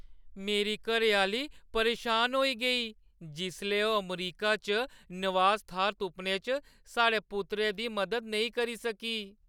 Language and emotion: Dogri, sad